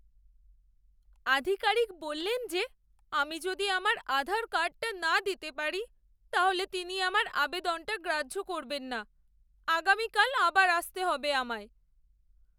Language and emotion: Bengali, sad